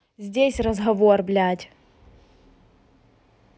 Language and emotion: Russian, angry